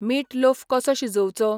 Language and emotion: Goan Konkani, neutral